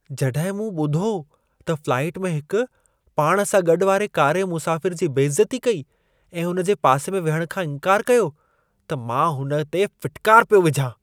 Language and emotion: Sindhi, disgusted